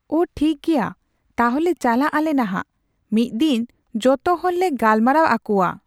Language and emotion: Santali, neutral